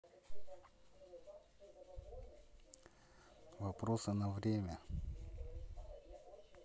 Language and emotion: Russian, neutral